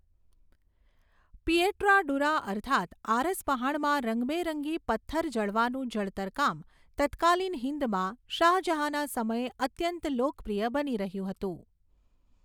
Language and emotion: Gujarati, neutral